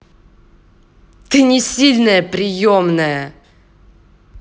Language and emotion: Russian, angry